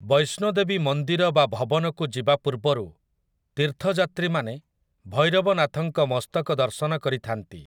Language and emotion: Odia, neutral